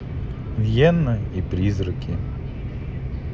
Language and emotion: Russian, neutral